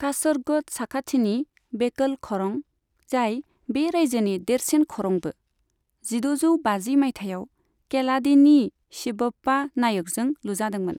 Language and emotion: Bodo, neutral